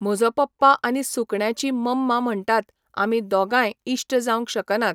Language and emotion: Goan Konkani, neutral